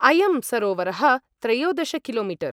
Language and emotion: Sanskrit, neutral